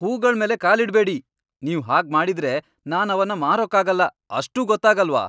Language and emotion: Kannada, angry